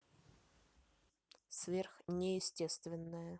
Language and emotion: Russian, neutral